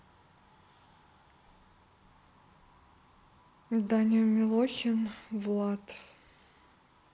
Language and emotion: Russian, neutral